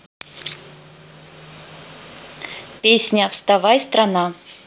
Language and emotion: Russian, neutral